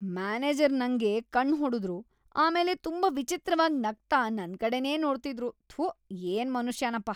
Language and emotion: Kannada, disgusted